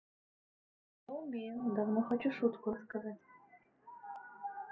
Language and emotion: Russian, neutral